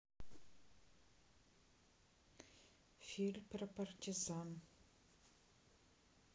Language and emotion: Russian, neutral